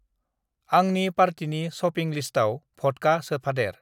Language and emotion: Bodo, neutral